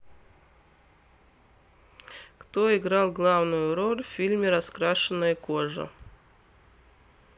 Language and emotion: Russian, neutral